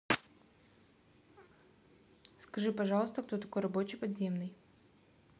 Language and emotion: Russian, neutral